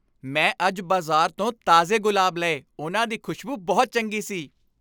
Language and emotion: Punjabi, happy